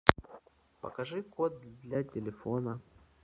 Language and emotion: Russian, neutral